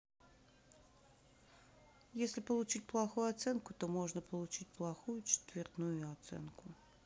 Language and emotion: Russian, neutral